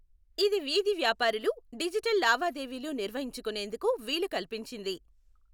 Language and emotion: Telugu, neutral